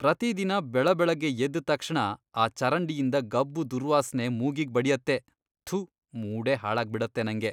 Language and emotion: Kannada, disgusted